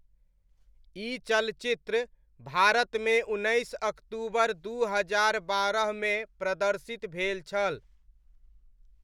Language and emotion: Maithili, neutral